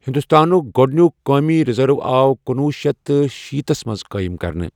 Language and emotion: Kashmiri, neutral